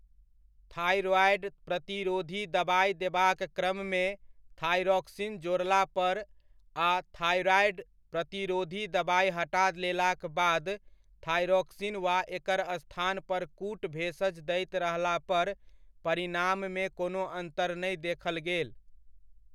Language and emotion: Maithili, neutral